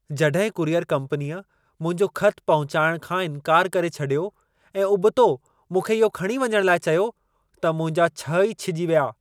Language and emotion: Sindhi, angry